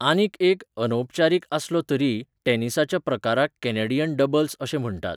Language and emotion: Goan Konkani, neutral